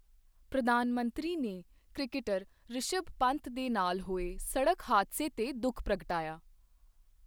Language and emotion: Punjabi, neutral